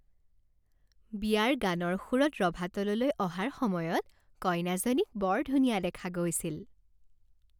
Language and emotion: Assamese, happy